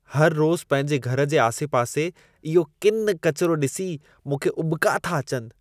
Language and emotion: Sindhi, disgusted